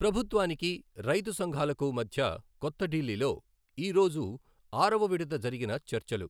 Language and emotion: Telugu, neutral